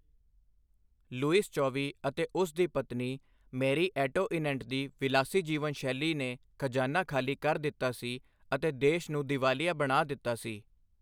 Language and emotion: Punjabi, neutral